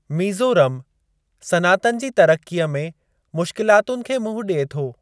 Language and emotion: Sindhi, neutral